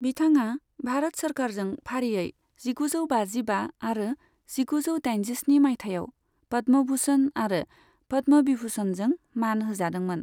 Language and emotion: Bodo, neutral